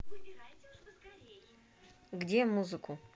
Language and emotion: Russian, neutral